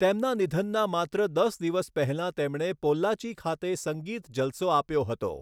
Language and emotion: Gujarati, neutral